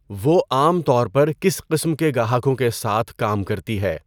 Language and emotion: Urdu, neutral